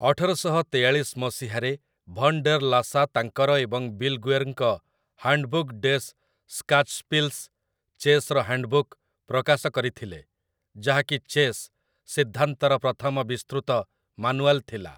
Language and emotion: Odia, neutral